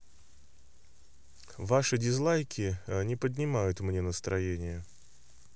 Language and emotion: Russian, neutral